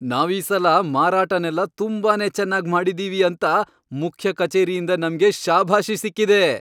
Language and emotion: Kannada, happy